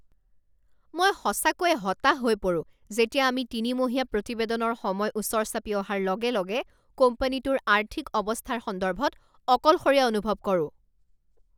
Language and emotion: Assamese, angry